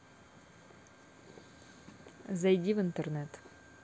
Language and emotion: Russian, neutral